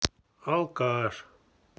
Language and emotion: Russian, neutral